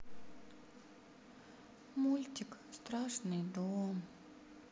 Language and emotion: Russian, sad